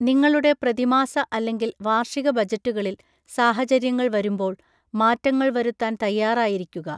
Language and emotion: Malayalam, neutral